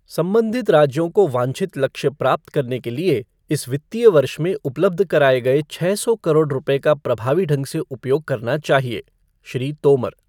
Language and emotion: Hindi, neutral